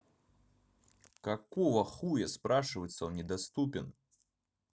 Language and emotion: Russian, angry